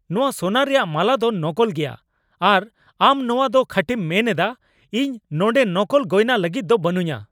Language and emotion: Santali, angry